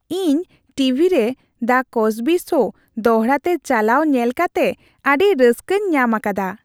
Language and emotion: Santali, happy